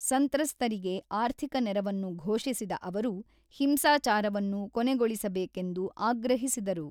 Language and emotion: Kannada, neutral